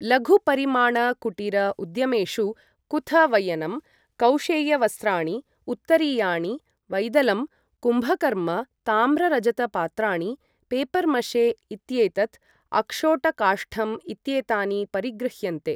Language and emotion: Sanskrit, neutral